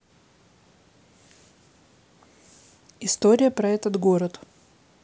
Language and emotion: Russian, neutral